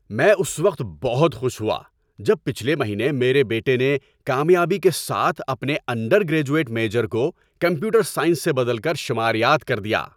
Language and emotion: Urdu, happy